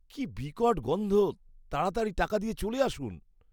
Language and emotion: Bengali, disgusted